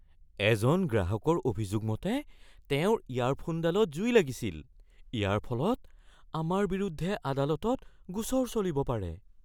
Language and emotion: Assamese, fearful